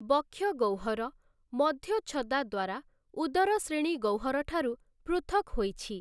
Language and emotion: Odia, neutral